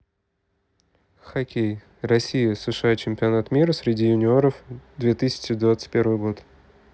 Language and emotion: Russian, neutral